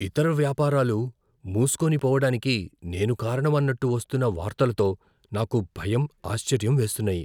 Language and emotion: Telugu, fearful